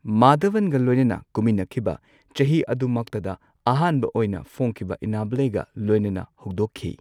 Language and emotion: Manipuri, neutral